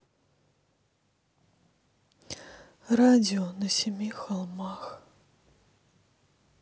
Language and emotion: Russian, sad